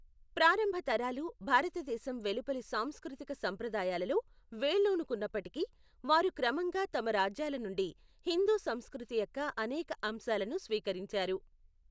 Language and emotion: Telugu, neutral